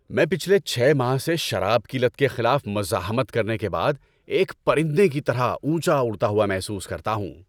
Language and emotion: Urdu, happy